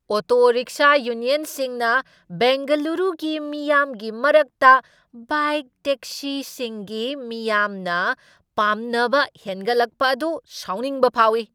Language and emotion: Manipuri, angry